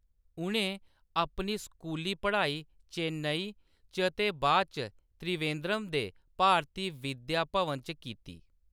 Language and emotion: Dogri, neutral